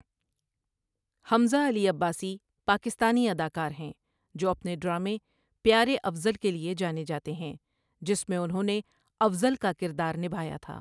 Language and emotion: Urdu, neutral